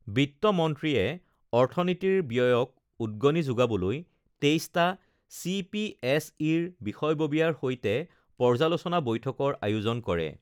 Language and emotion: Assamese, neutral